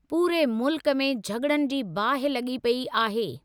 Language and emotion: Sindhi, neutral